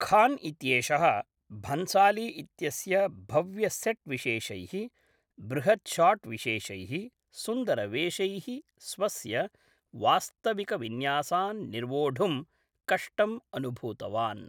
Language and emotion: Sanskrit, neutral